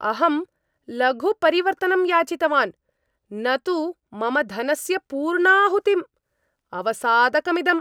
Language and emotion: Sanskrit, angry